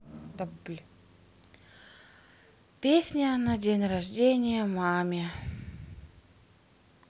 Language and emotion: Russian, sad